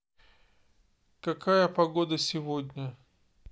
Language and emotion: Russian, neutral